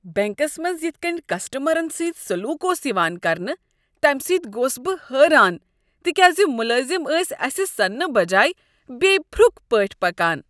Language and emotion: Kashmiri, disgusted